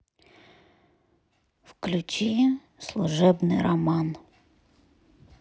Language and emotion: Russian, neutral